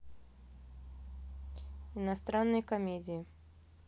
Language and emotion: Russian, neutral